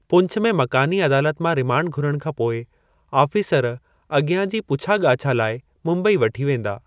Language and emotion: Sindhi, neutral